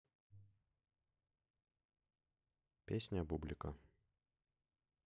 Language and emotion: Russian, neutral